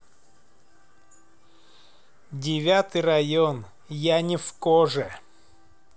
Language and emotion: Russian, neutral